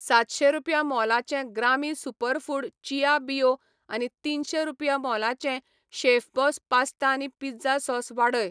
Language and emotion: Goan Konkani, neutral